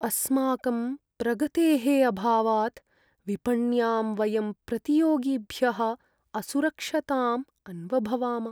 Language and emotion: Sanskrit, sad